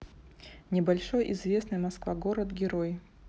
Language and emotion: Russian, neutral